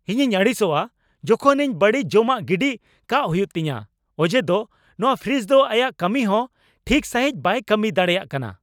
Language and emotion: Santali, angry